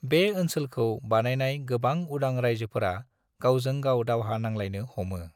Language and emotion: Bodo, neutral